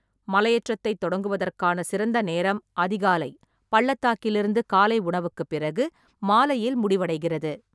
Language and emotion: Tamil, neutral